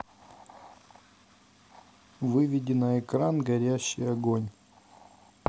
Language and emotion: Russian, neutral